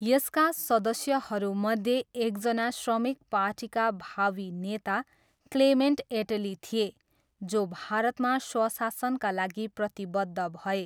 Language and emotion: Nepali, neutral